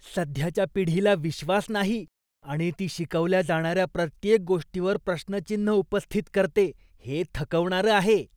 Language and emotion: Marathi, disgusted